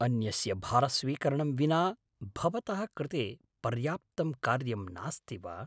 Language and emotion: Sanskrit, surprised